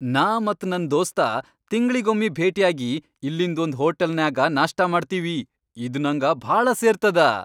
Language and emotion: Kannada, happy